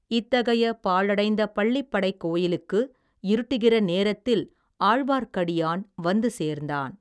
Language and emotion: Tamil, neutral